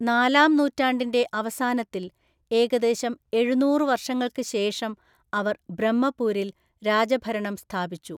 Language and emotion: Malayalam, neutral